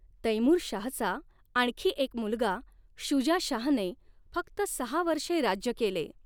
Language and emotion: Marathi, neutral